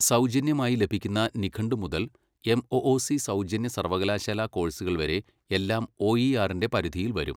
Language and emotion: Malayalam, neutral